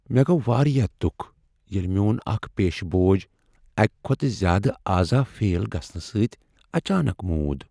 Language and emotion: Kashmiri, sad